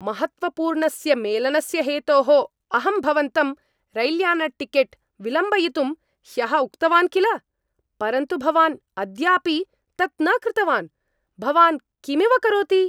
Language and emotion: Sanskrit, angry